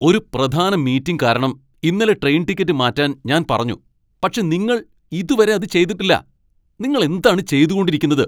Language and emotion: Malayalam, angry